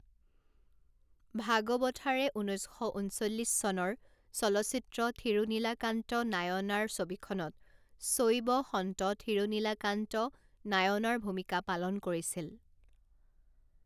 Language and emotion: Assamese, neutral